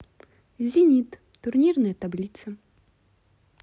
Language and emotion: Russian, neutral